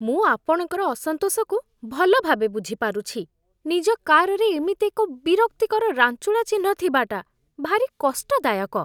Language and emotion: Odia, disgusted